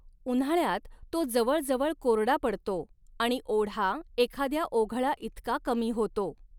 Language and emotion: Marathi, neutral